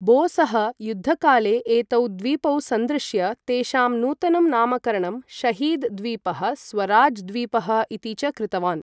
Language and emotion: Sanskrit, neutral